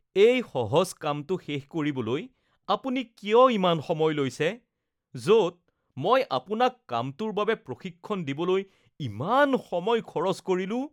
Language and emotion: Assamese, disgusted